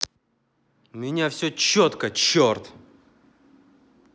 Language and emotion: Russian, angry